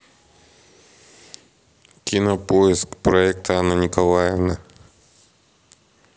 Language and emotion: Russian, neutral